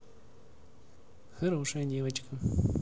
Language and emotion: Russian, positive